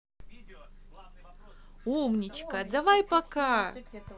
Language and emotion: Russian, positive